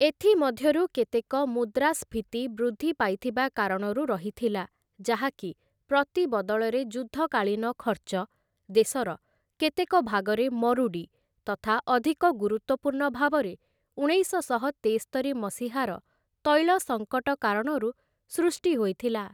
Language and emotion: Odia, neutral